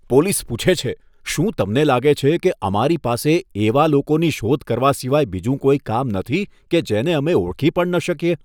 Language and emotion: Gujarati, disgusted